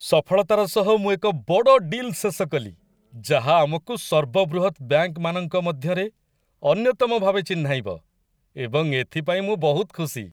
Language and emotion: Odia, happy